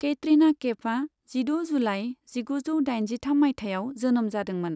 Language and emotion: Bodo, neutral